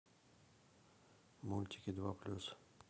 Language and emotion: Russian, neutral